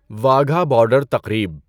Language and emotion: Urdu, neutral